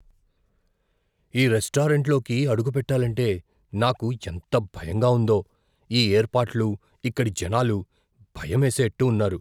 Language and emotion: Telugu, fearful